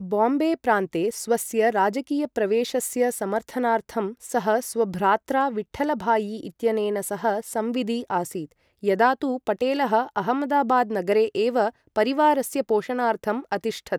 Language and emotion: Sanskrit, neutral